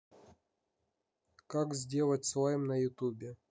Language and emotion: Russian, neutral